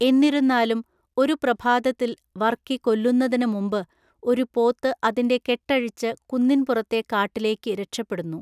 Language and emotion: Malayalam, neutral